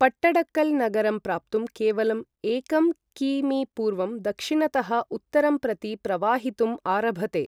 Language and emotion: Sanskrit, neutral